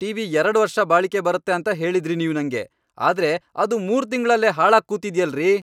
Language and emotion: Kannada, angry